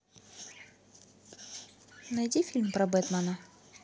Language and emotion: Russian, neutral